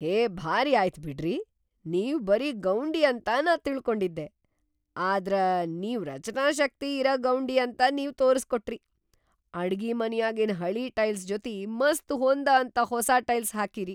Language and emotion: Kannada, surprised